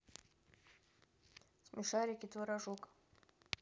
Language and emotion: Russian, neutral